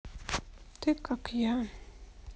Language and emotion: Russian, sad